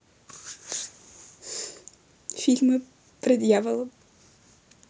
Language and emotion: Russian, sad